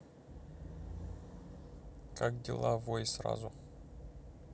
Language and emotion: Russian, neutral